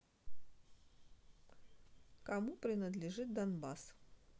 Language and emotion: Russian, neutral